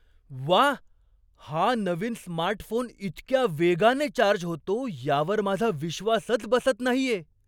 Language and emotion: Marathi, surprised